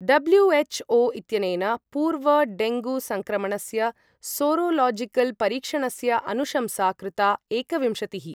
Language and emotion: Sanskrit, neutral